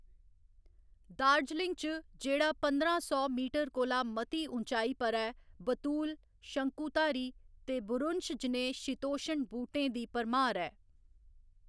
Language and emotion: Dogri, neutral